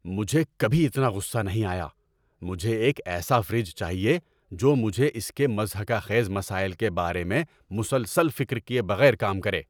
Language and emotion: Urdu, angry